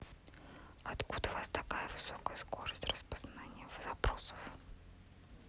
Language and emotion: Russian, neutral